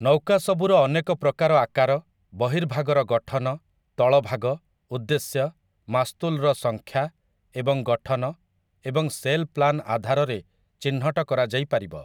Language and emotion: Odia, neutral